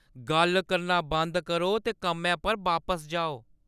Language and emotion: Dogri, angry